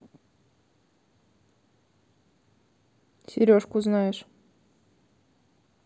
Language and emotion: Russian, neutral